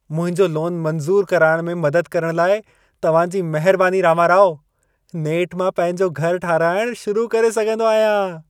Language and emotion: Sindhi, happy